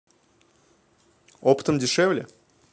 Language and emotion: Russian, neutral